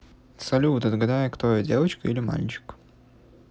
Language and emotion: Russian, neutral